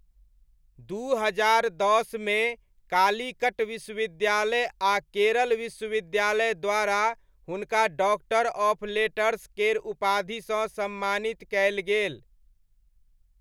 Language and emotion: Maithili, neutral